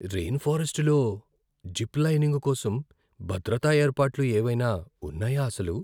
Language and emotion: Telugu, fearful